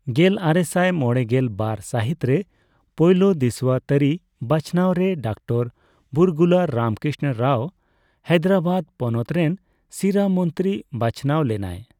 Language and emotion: Santali, neutral